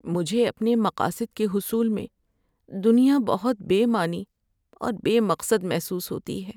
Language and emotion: Urdu, sad